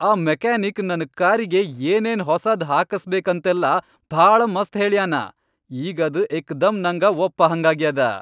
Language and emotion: Kannada, happy